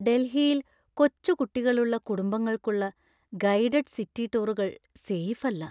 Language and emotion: Malayalam, fearful